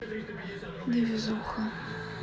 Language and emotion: Russian, sad